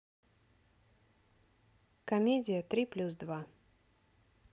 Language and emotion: Russian, neutral